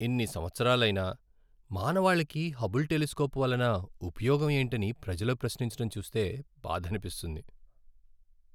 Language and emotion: Telugu, sad